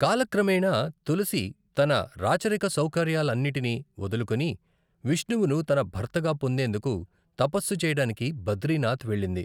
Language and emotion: Telugu, neutral